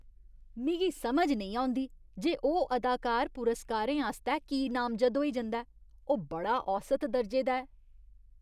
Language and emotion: Dogri, disgusted